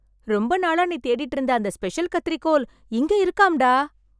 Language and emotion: Tamil, happy